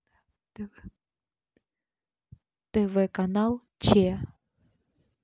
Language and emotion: Russian, neutral